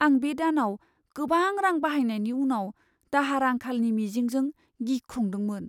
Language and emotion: Bodo, fearful